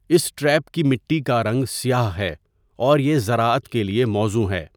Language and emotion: Urdu, neutral